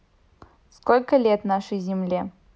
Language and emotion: Russian, neutral